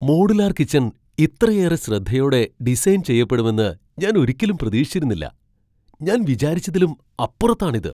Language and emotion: Malayalam, surprised